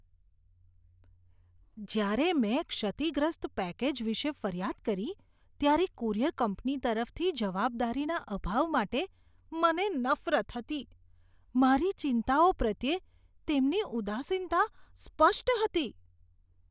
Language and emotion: Gujarati, disgusted